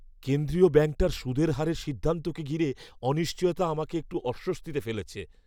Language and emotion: Bengali, fearful